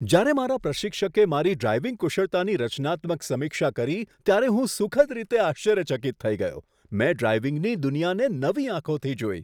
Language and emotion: Gujarati, surprised